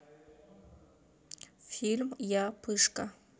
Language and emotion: Russian, neutral